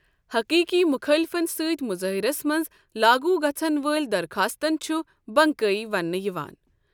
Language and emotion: Kashmiri, neutral